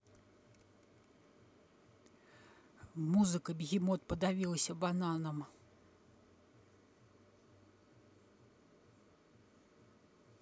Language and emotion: Russian, neutral